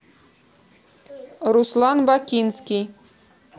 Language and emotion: Russian, neutral